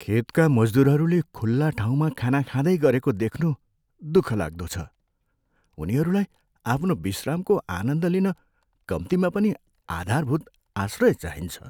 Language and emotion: Nepali, sad